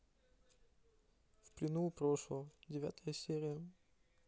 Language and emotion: Russian, neutral